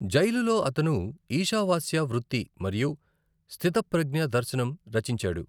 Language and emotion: Telugu, neutral